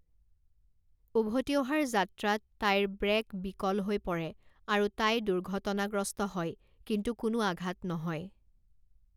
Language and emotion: Assamese, neutral